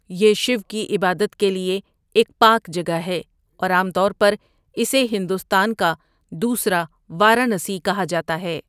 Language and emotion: Urdu, neutral